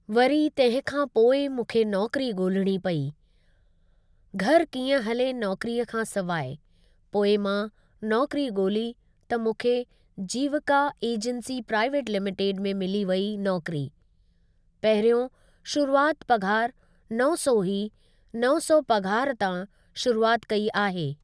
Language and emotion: Sindhi, neutral